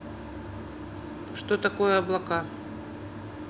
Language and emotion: Russian, neutral